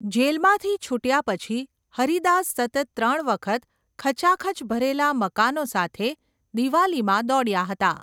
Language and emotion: Gujarati, neutral